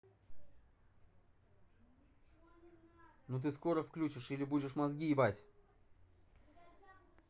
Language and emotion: Russian, angry